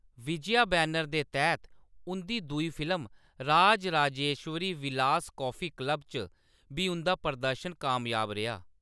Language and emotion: Dogri, neutral